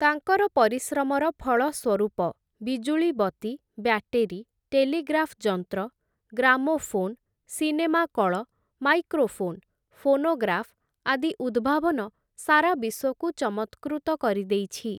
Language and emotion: Odia, neutral